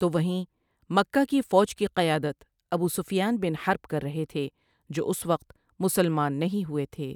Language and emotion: Urdu, neutral